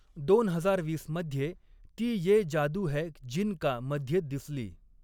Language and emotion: Marathi, neutral